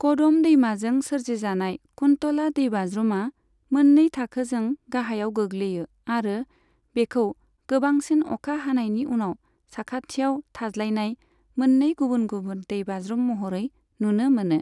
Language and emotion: Bodo, neutral